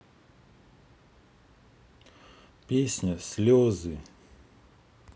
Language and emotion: Russian, neutral